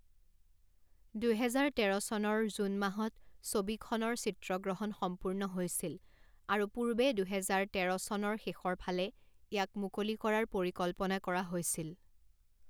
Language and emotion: Assamese, neutral